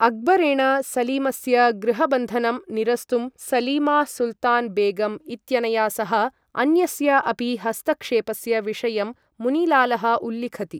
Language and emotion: Sanskrit, neutral